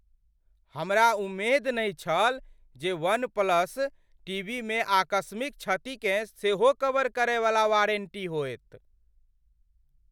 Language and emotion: Maithili, surprised